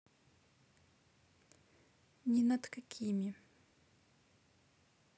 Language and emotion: Russian, neutral